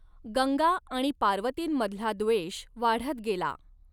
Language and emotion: Marathi, neutral